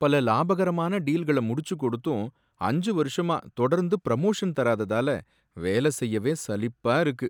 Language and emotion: Tamil, sad